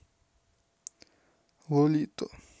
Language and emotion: Russian, neutral